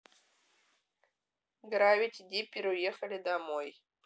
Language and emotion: Russian, neutral